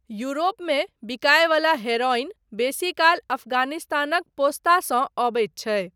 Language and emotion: Maithili, neutral